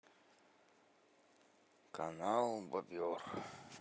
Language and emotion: Russian, sad